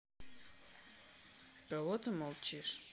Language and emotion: Russian, neutral